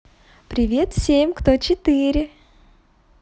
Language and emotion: Russian, positive